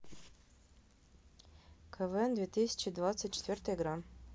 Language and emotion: Russian, neutral